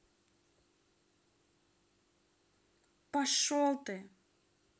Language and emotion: Russian, angry